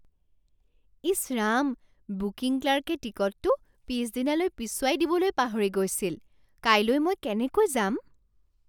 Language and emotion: Assamese, surprised